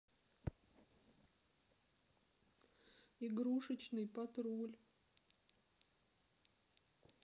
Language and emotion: Russian, sad